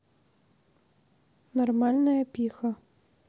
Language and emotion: Russian, neutral